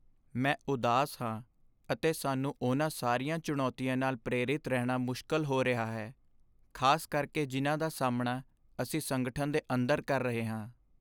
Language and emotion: Punjabi, sad